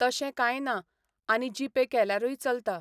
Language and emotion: Goan Konkani, neutral